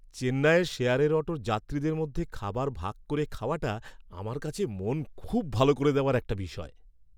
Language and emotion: Bengali, happy